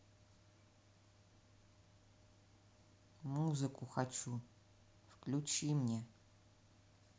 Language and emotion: Russian, neutral